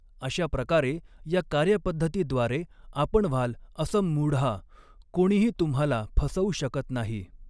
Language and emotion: Marathi, neutral